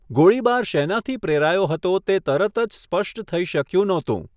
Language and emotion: Gujarati, neutral